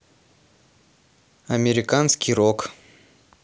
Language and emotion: Russian, neutral